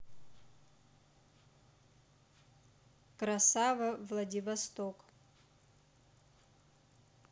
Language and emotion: Russian, neutral